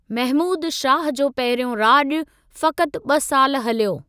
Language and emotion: Sindhi, neutral